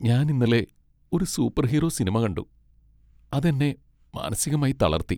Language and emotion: Malayalam, sad